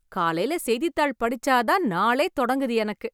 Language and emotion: Tamil, happy